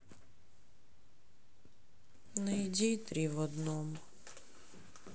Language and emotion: Russian, sad